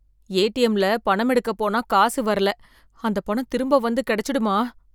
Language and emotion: Tamil, fearful